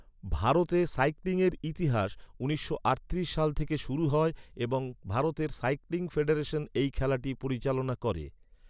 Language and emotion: Bengali, neutral